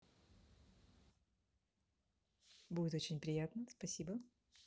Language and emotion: Russian, positive